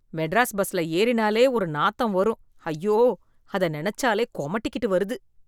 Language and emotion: Tamil, disgusted